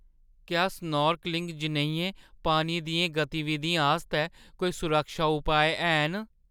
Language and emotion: Dogri, fearful